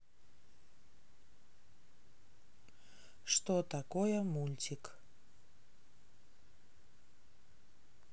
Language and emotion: Russian, neutral